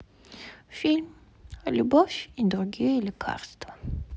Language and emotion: Russian, sad